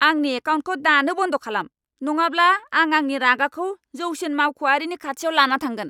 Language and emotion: Bodo, angry